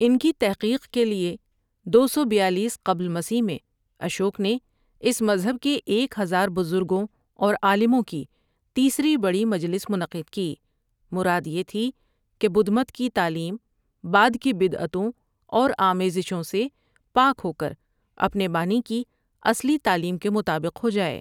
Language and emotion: Urdu, neutral